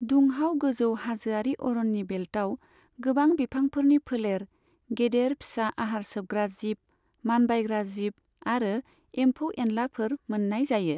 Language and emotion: Bodo, neutral